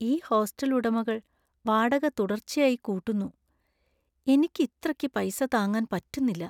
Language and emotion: Malayalam, sad